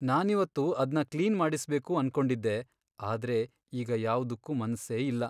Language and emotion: Kannada, sad